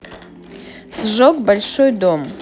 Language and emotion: Russian, neutral